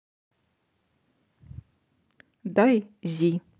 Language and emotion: Russian, neutral